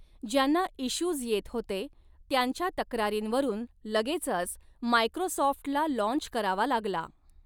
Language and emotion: Marathi, neutral